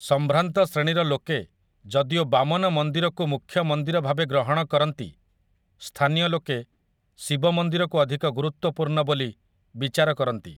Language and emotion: Odia, neutral